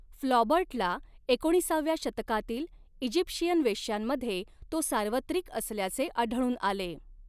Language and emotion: Marathi, neutral